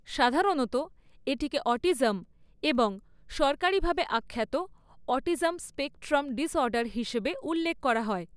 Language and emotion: Bengali, neutral